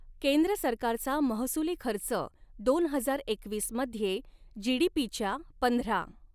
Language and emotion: Marathi, neutral